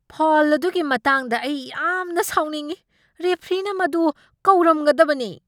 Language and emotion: Manipuri, angry